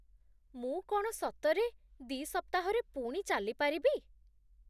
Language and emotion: Odia, surprised